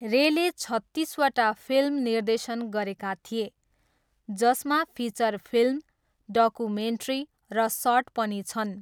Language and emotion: Nepali, neutral